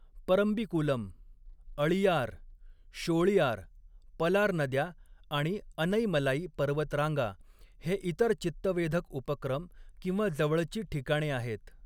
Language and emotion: Marathi, neutral